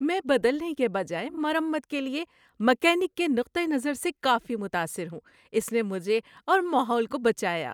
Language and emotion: Urdu, happy